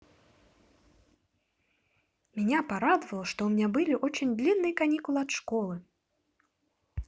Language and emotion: Russian, positive